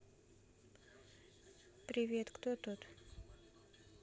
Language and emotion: Russian, neutral